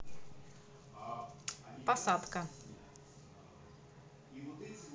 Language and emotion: Russian, neutral